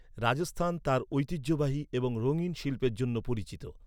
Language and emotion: Bengali, neutral